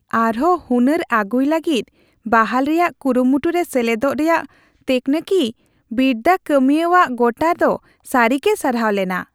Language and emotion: Santali, happy